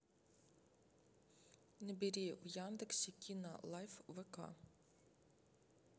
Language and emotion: Russian, neutral